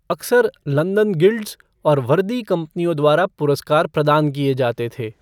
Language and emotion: Hindi, neutral